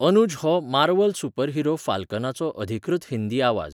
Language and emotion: Goan Konkani, neutral